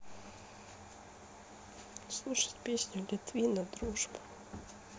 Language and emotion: Russian, sad